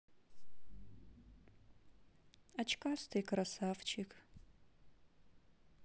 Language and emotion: Russian, sad